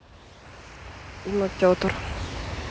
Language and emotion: Russian, neutral